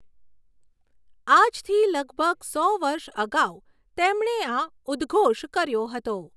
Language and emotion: Gujarati, neutral